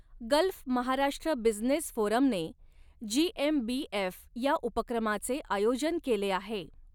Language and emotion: Marathi, neutral